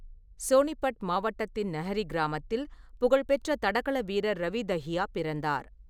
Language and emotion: Tamil, neutral